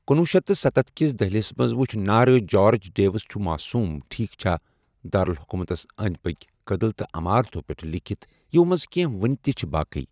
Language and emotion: Kashmiri, neutral